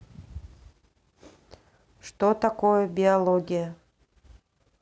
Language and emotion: Russian, neutral